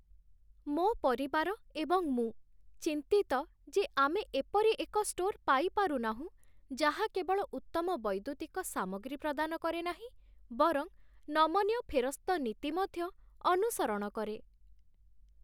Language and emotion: Odia, sad